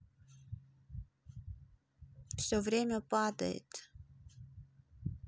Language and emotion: Russian, sad